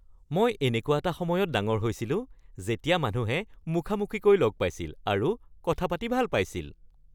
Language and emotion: Assamese, happy